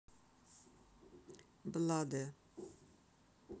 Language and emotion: Russian, neutral